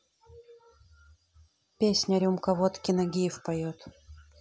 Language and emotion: Russian, neutral